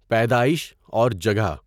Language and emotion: Urdu, neutral